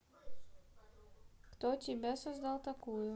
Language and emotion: Russian, neutral